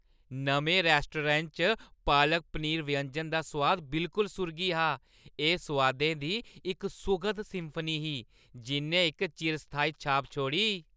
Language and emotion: Dogri, happy